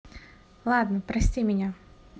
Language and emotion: Russian, neutral